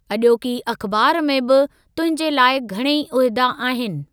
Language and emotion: Sindhi, neutral